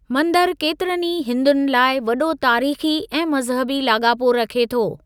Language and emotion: Sindhi, neutral